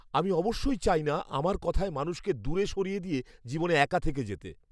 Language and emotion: Bengali, fearful